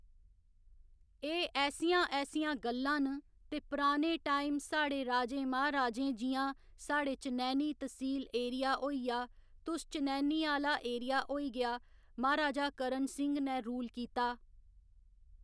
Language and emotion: Dogri, neutral